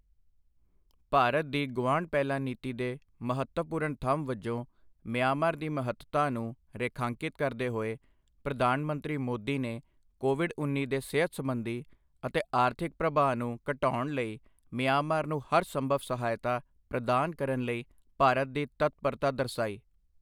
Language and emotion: Punjabi, neutral